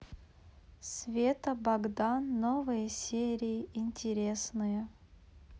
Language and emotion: Russian, neutral